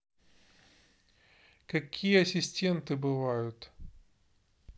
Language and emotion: Russian, neutral